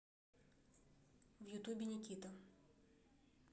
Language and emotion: Russian, neutral